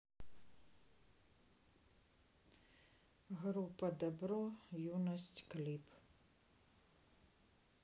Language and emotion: Russian, sad